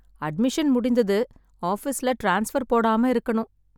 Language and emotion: Tamil, sad